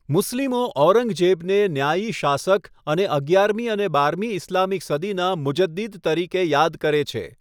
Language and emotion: Gujarati, neutral